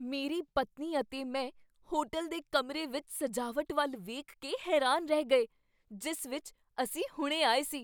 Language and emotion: Punjabi, surprised